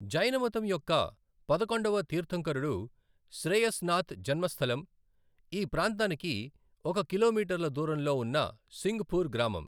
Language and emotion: Telugu, neutral